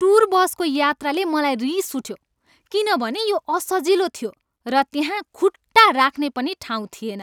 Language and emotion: Nepali, angry